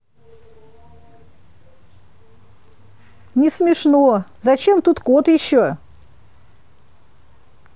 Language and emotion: Russian, neutral